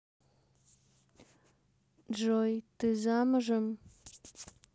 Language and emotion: Russian, neutral